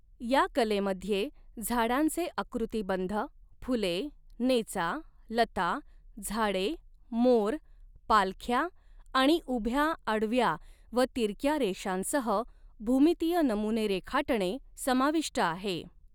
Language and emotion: Marathi, neutral